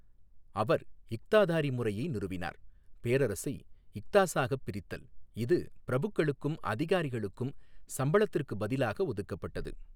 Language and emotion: Tamil, neutral